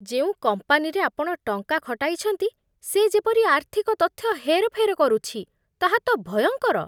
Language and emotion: Odia, disgusted